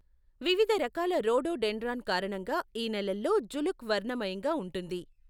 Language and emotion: Telugu, neutral